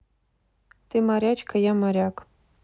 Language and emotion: Russian, neutral